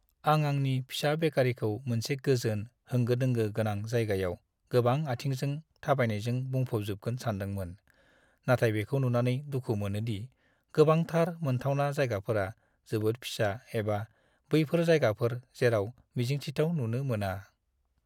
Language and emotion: Bodo, sad